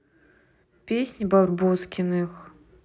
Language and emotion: Russian, neutral